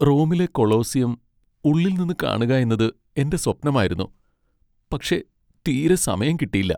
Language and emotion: Malayalam, sad